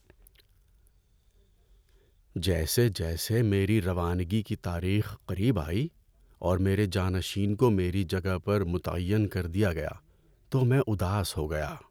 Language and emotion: Urdu, sad